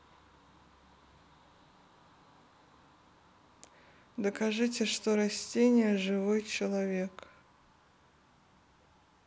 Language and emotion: Russian, neutral